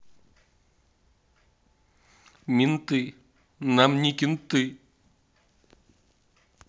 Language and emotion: Russian, sad